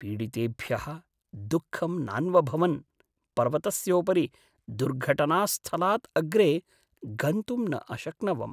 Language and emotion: Sanskrit, sad